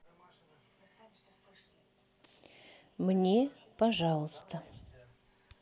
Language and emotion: Russian, neutral